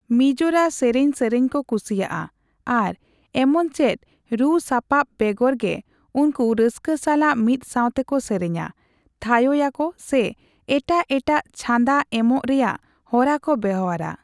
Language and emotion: Santali, neutral